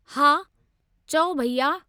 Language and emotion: Sindhi, neutral